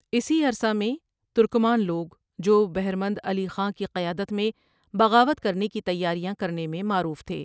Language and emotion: Urdu, neutral